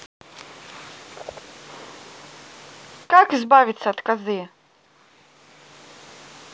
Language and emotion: Russian, neutral